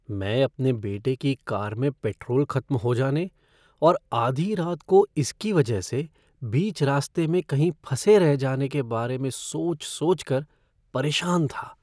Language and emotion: Hindi, fearful